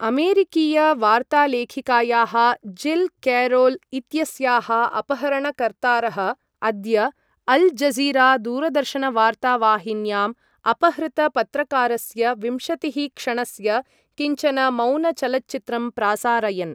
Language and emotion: Sanskrit, neutral